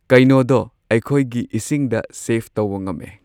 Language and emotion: Manipuri, neutral